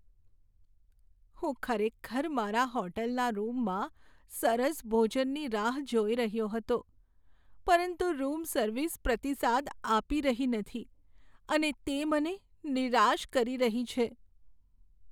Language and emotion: Gujarati, sad